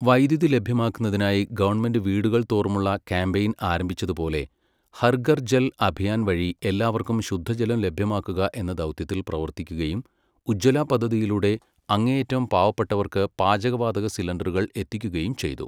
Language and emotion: Malayalam, neutral